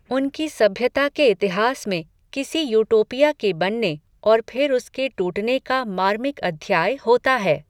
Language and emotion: Hindi, neutral